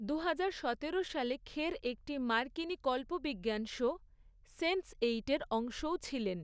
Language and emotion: Bengali, neutral